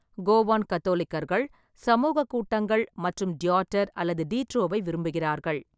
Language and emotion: Tamil, neutral